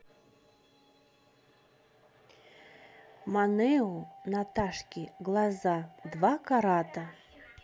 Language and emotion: Russian, neutral